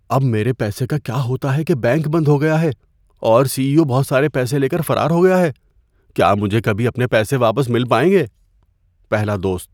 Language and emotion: Urdu, fearful